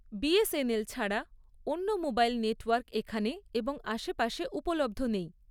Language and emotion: Bengali, neutral